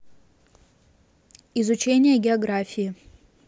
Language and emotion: Russian, neutral